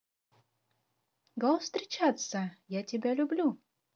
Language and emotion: Russian, positive